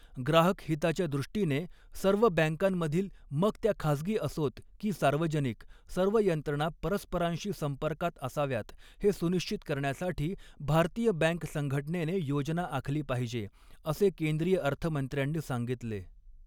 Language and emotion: Marathi, neutral